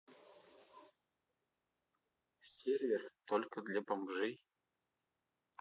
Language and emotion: Russian, neutral